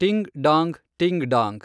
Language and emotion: Kannada, neutral